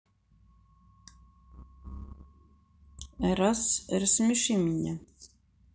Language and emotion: Russian, neutral